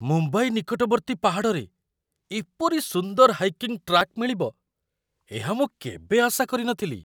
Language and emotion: Odia, surprised